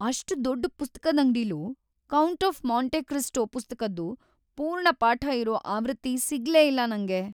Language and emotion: Kannada, sad